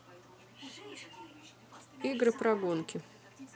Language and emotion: Russian, neutral